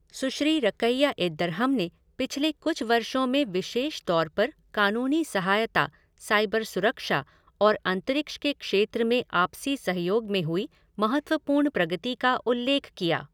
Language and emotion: Hindi, neutral